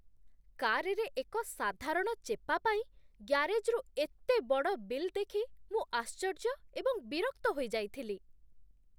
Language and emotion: Odia, disgusted